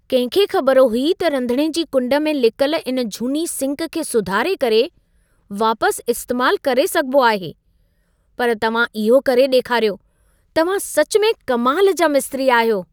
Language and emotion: Sindhi, surprised